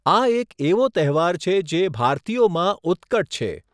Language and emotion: Gujarati, neutral